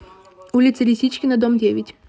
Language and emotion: Russian, positive